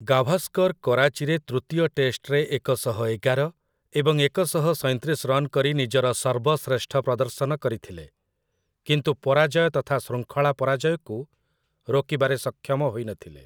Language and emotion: Odia, neutral